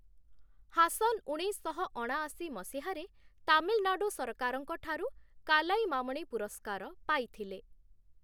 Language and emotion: Odia, neutral